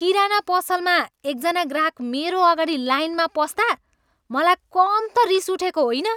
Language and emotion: Nepali, angry